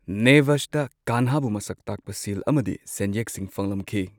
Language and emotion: Manipuri, neutral